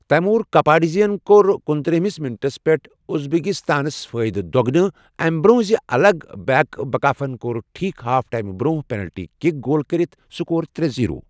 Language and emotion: Kashmiri, neutral